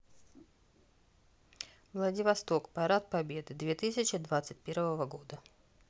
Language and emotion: Russian, neutral